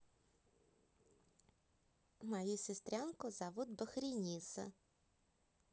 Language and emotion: Russian, positive